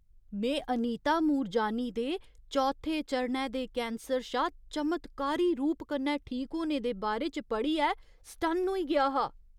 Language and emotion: Dogri, surprised